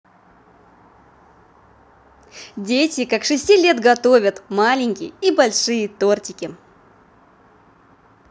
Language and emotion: Russian, positive